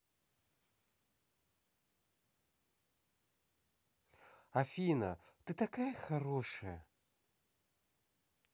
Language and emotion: Russian, positive